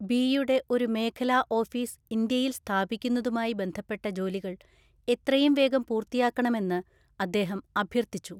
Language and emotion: Malayalam, neutral